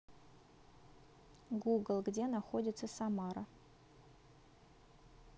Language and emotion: Russian, neutral